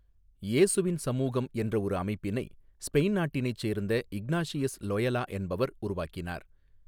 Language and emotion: Tamil, neutral